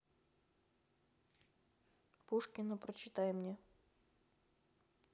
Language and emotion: Russian, neutral